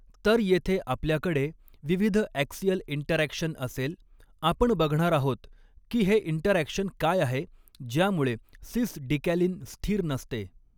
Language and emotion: Marathi, neutral